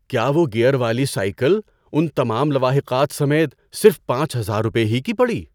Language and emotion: Urdu, surprised